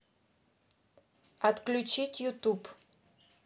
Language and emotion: Russian, neutral